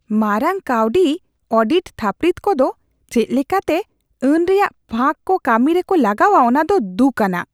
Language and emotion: Santali, disgusted